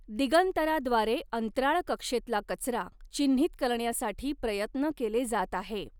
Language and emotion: Marathi, neutral